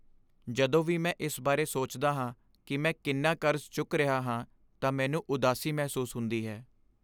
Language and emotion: Punjabi, sad